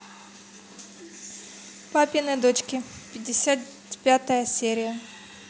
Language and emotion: Russian, neutral